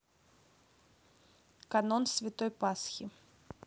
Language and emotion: Russian, neutral